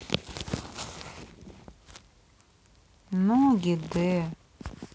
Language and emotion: Russian, sad